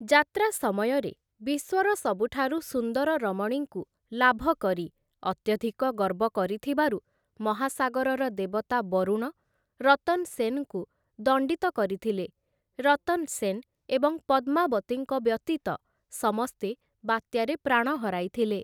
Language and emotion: Odia, neutral